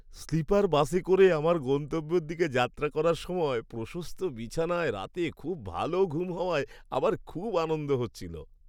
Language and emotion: Bengali, happy